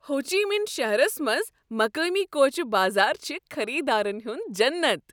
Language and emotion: Kashmiri, happy